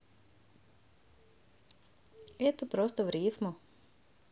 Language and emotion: Russian, neutral